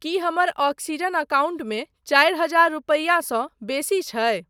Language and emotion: Maithili, neutral